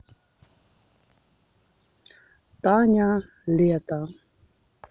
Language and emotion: Russian, neutral